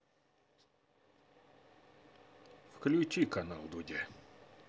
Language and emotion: Russian, neutral